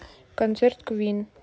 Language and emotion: Russian, neutral